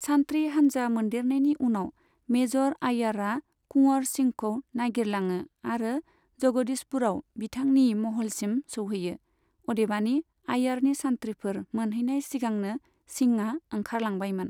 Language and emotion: Bodo, neutral